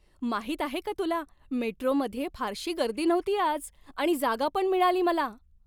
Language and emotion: Marathi, happy